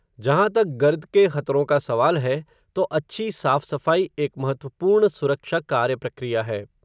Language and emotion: Hindi, neutral